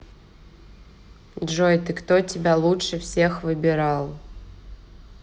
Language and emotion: Russian, neutral